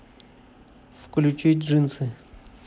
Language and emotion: Russian, neutral